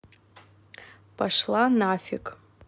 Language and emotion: Russian, neutral